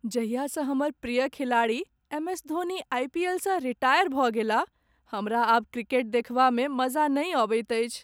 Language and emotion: Maithili, sad